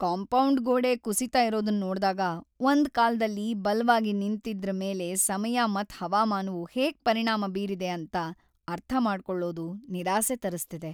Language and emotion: Kannada, sad